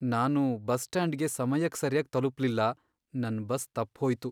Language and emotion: Kannada, sad